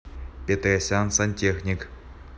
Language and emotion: Russian, neutral